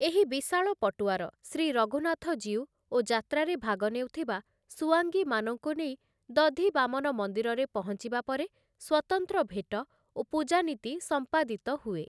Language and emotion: Odia, neutral